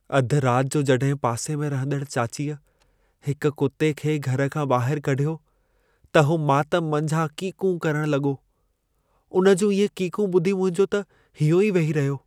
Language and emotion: Sindhi, sad